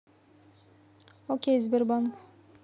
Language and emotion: Russian, neutral